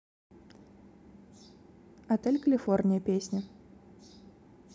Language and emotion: Russian, neutral